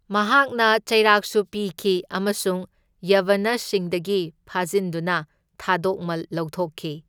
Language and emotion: Manipuri, neutral